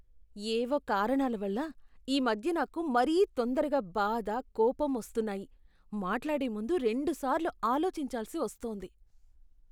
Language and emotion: Telugu, disgusted